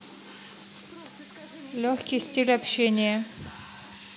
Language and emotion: Russian, neutral